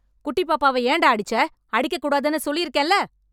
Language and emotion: Tamil, angry